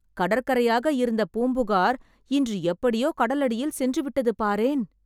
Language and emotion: Tamil, surprised